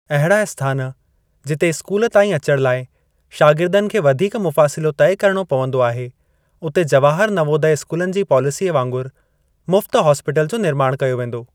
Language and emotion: Sindhi, neutral